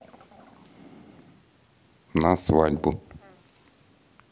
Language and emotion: Russian, neutral